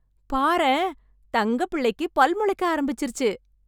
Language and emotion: Tamil, happy